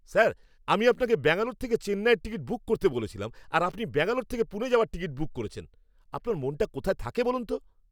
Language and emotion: Bengali, angry